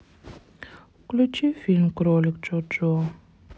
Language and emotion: Russian, sad